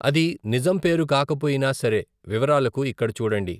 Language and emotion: Telugu, neutral